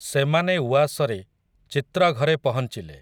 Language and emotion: Odia, neutral